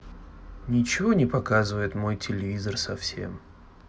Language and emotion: Russian, sad